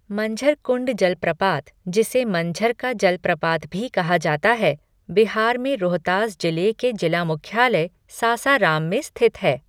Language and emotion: Hindi, neutral